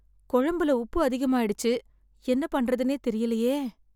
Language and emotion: Tamil, sad